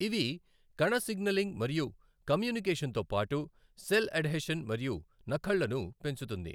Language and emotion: Telugu, neutral